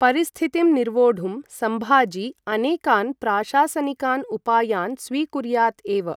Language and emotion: Sanskrit, neutral